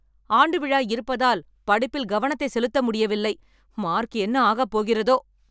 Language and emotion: Tamil, angry